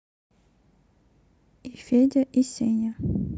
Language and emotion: Russian, neutral